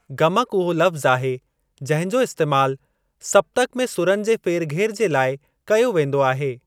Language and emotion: Sindhi, neutral